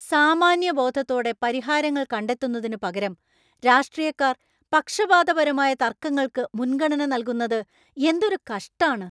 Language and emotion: Malayalam, angry